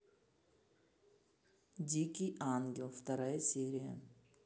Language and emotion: Russian, neutral